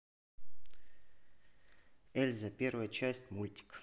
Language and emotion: Russian, neutral